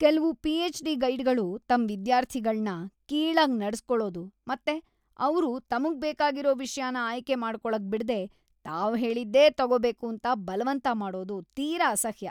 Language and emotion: Kannada, disgusted